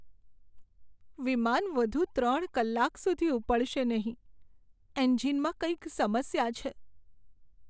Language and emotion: Gujarati, sad